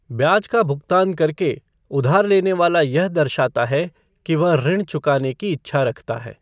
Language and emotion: Hindi, neutral